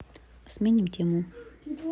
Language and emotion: Russian, neutral